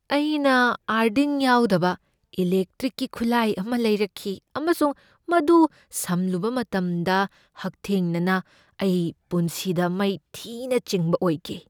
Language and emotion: Manipuri, fearful